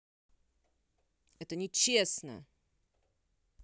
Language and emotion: Russian, angry